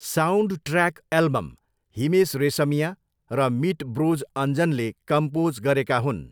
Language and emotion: Nepali, neutral